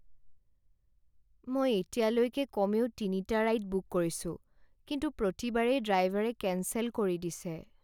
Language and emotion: Assamese, sad